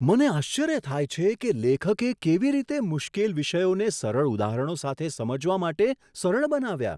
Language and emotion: Gujarati, surprised